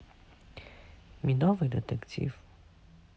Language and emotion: Russian, neutral